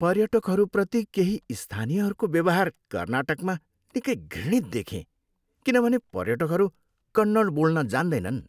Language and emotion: Nepali, disgusted